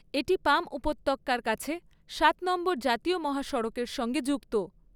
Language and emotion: Bengali, neutral